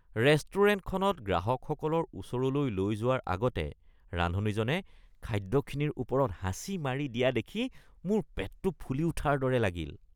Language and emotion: Assamese, disgusted